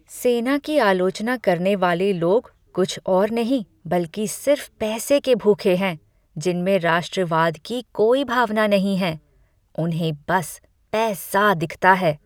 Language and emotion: Hindi, disgusted